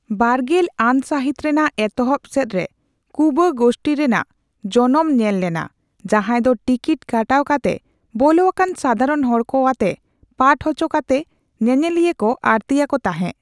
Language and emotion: Santali, neutral